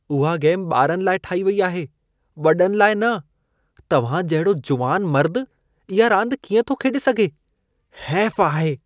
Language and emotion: Sindhi, disgusted